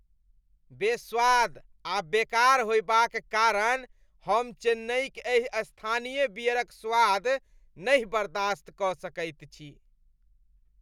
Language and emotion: Maithili, disgusted